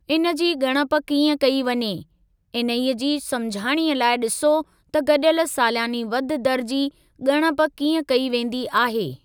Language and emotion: Sindhi, neutral